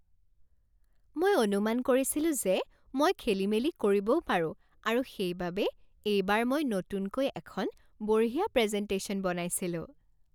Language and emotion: Assamese, happy